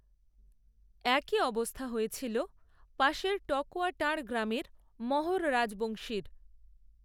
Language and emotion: Bengali, neutral